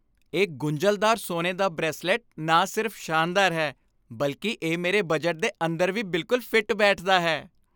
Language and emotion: Punjabi, happy